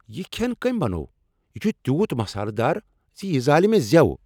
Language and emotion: Kashmiri, angry